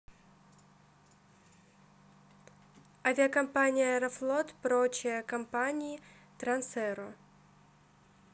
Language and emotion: Russian, neutral